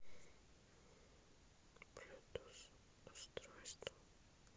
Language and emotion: Russian, neutral